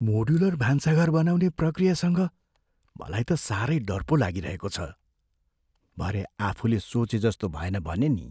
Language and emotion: Nepali, fearful